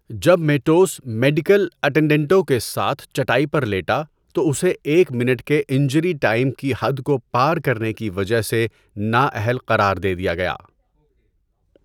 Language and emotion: Urdu, neutral